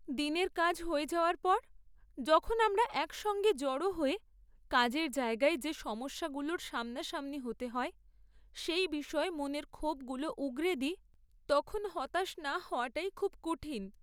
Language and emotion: Bengali, sad